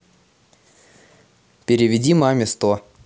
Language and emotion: Russian, neutral